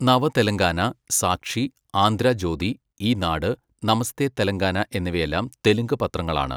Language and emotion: Malayalam, neutral